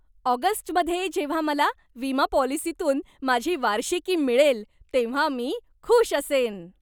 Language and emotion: Marathi, happy